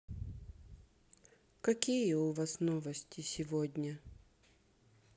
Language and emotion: Russian, sad